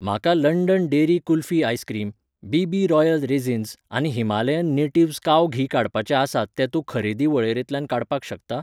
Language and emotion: Goan Konkani, neutral